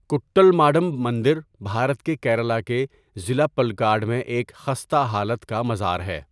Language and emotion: Urdu, neutral